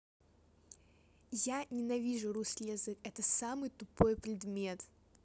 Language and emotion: Russian, neutral